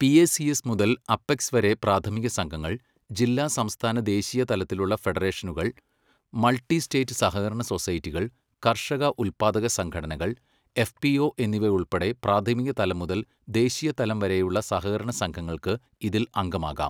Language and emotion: Malayalam, neutral